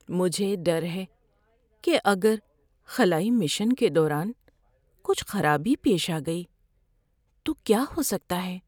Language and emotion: Urdu, fearful